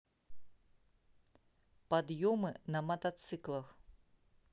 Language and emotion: Russian, neutral